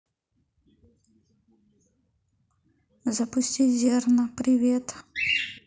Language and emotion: Russian, neutral